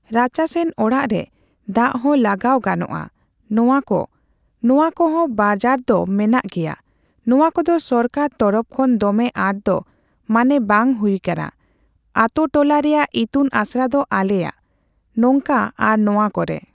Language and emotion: Santali, neutral